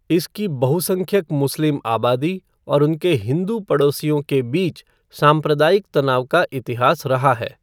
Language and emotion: Hindi, neutral